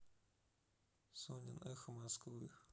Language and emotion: Russian, neutral